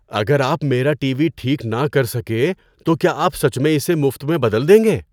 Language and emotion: Urdu, surprised